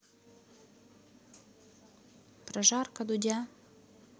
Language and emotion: Russian, neutral